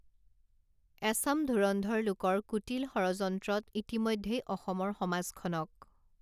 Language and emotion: Assamese, neutral